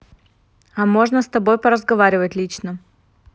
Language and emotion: Russian, neutral